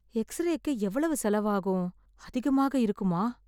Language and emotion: Tamil, fearful